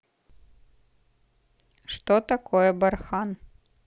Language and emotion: Russian, neutral